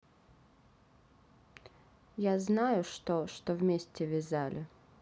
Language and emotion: Russian, neutral